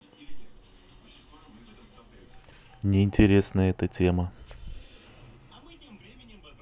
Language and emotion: Russian, neutral